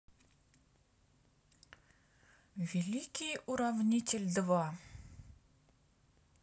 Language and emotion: Russian, neutral